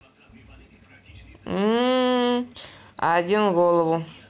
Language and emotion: Russian, neutral